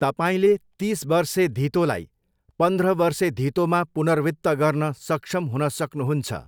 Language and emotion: Nepali, neutral